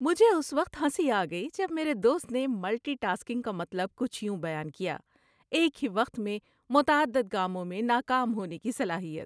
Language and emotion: Urdu, happy